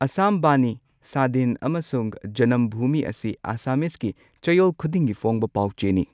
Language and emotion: Manipuri, neutral